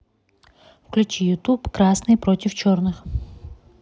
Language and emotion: Russian, neutral